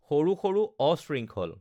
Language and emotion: Assamese, neutral